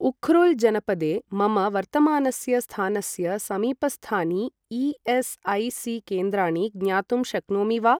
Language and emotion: Sanskrit, neutral